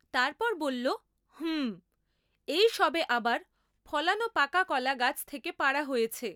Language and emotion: Bengali, neutral